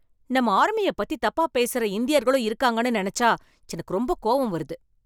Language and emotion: Tamil, angry